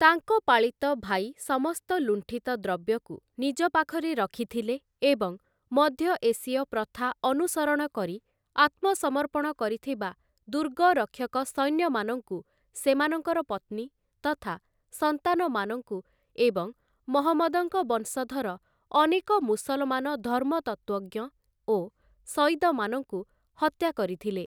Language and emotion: Odia, neutral